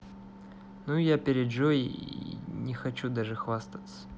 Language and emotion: Russian, neutral